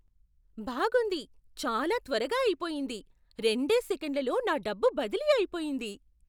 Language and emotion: Telugu, surprised